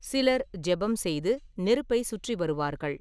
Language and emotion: Tamil, neutral